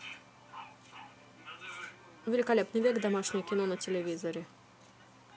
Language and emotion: Russian, neutral